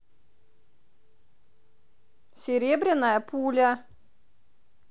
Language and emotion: Russian, positive